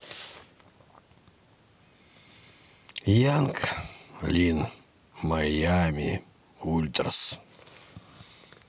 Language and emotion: Russian, sad